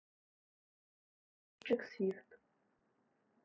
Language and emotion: Russian, neutral